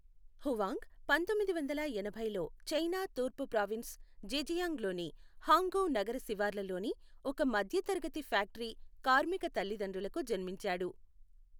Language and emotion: Telugu, neutral